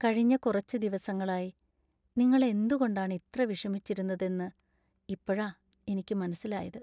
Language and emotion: Malayalam, sad